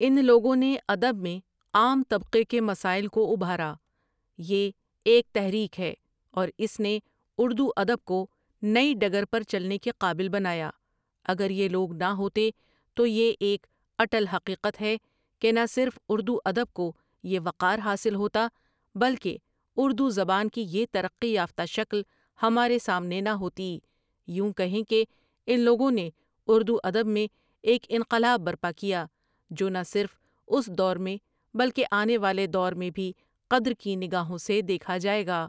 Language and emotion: Urdu, neutral